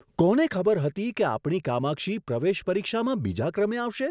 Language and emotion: Gujarati, surprised